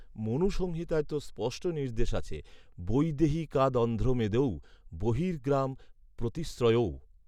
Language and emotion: Bengali, neutral